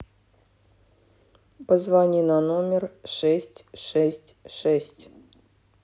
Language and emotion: Russian, neutral